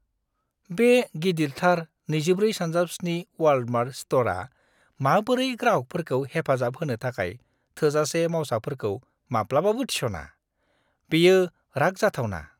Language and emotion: Bodo, disgusted